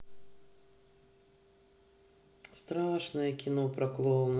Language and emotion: Russian, sad